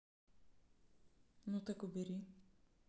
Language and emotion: Russian, neutral